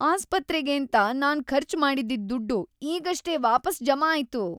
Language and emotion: Kannada, happy